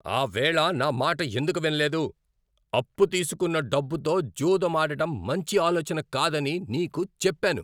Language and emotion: Telugu, angry